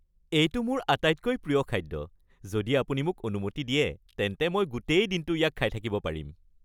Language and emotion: Assamese, happy